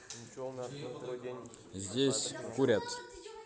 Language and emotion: Russian, neutral